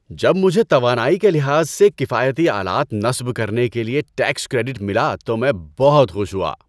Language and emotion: Urdu, happy